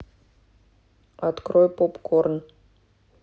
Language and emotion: Russian, neutral